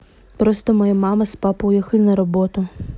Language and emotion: Russian, neutral